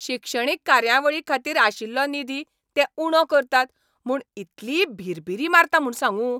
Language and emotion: Goan Konkani, angry